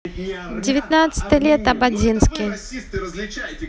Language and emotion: Russian, neutral